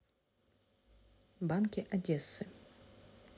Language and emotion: Russian, neutral